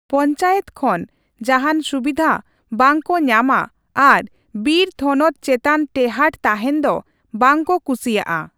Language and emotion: Santali, neutral